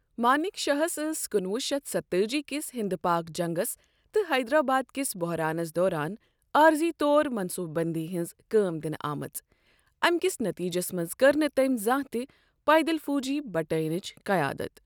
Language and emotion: Kashmiri, neutral